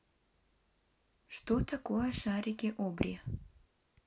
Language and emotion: Russian, neutral